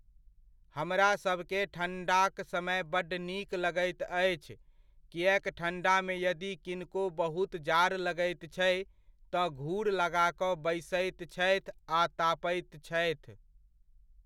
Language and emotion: Maithili, neutral